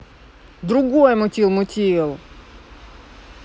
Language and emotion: Russian, angry